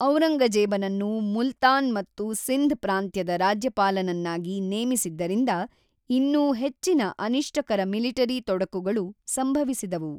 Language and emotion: Kannada, neutral